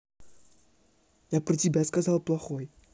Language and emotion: Russian, angry